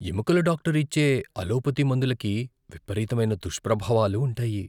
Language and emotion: Telugu, fearful